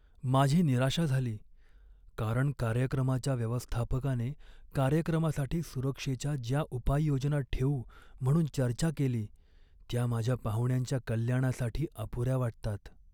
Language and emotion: Marathi, sad